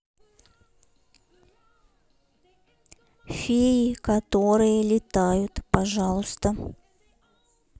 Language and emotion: Russian, neutral